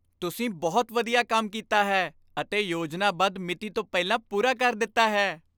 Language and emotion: Punjabi, happy